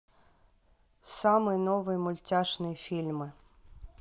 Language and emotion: Russian, neutral